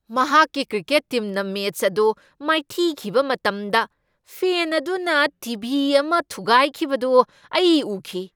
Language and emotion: Manipuri, angry